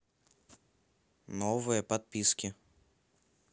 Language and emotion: Russian, neutral